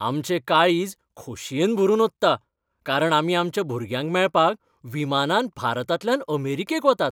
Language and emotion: Goan Konkani, happy